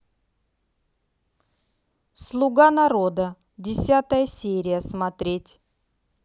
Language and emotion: Russian, neutral